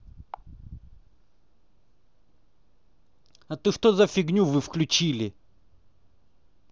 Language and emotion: Russian, angry